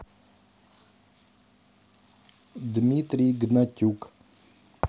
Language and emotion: Russian, neutral